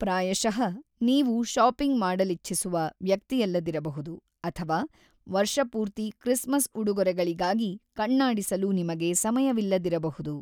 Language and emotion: Kannada, neutral